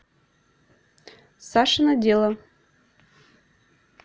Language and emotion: Russian, neutral